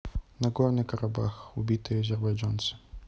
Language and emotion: Russian, neutral